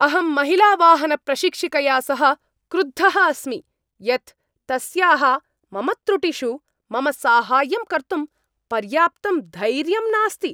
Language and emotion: Sanskrit, angry